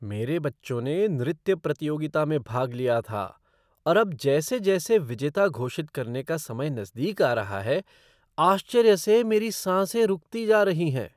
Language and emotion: Hindi, surprised